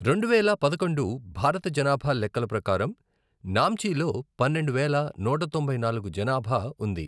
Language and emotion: Telugu, neutral